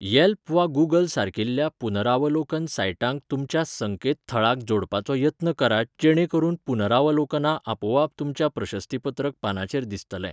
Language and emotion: Goan Konkani, neutral